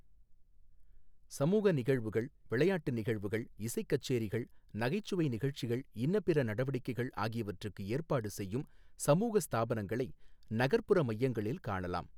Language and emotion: Tamil, neutral